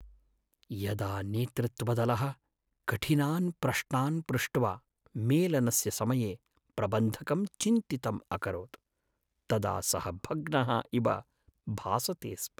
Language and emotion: Sanskrit, sad